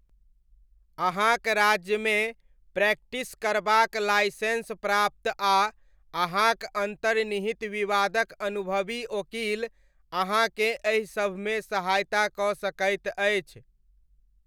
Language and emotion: Maithili, neutral